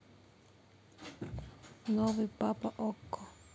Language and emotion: Russian, neutral